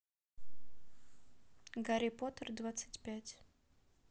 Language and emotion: Russian, neutral